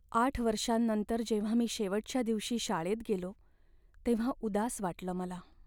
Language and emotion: Marathi, sad